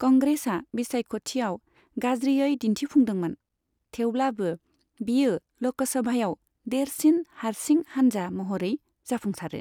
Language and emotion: Bodo, neutral